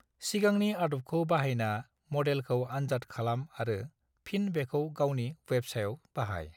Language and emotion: Bodo, neutral